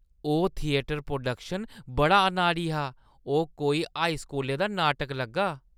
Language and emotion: Dogri, disgusted